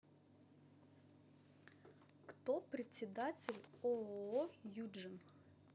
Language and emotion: Russian, neutral